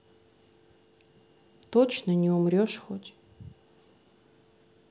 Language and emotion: Russian, sad